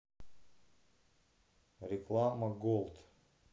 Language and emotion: Russian, neutral